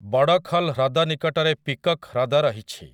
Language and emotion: Odia, neutral